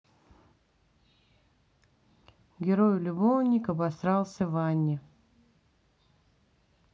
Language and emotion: Russian, neutral